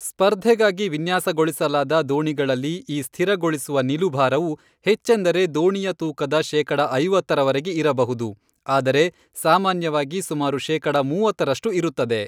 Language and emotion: Kannada, neutral